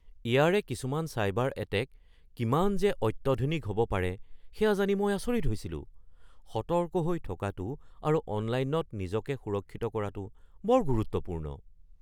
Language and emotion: Assamese, surprised